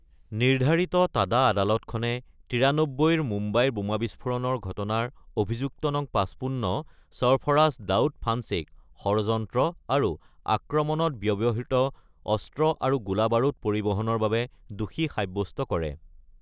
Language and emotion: Assamese, neutral